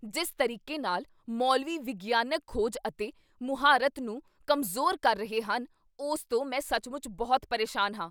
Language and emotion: Punjabi, angry